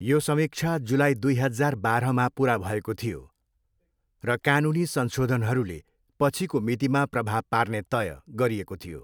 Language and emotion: Nepali, neutral